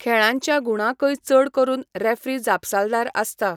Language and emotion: Goan Konkani, neutral